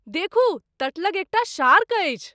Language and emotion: Maithili, surprised